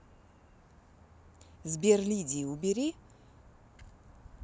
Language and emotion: Russian, neutral